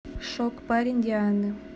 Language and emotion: Russian, neutral